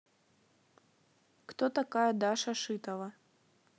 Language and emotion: Russian, neutral